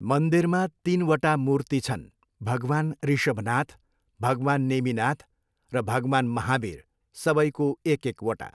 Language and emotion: Nepali, neutral